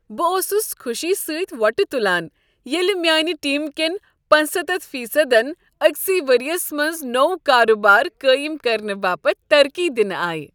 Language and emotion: Kashmiri, happy